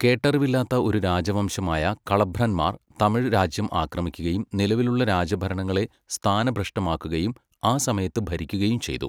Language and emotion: Malayalam, neutral